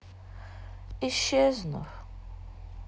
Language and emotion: Russian, sad